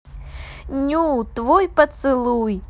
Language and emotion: Russian, positive